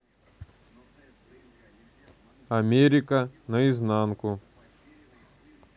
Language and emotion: Russian, neutral